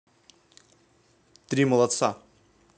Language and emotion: Russian, neutral